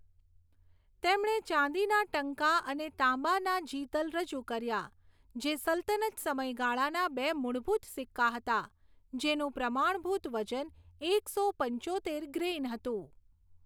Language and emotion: Gujarati, neutral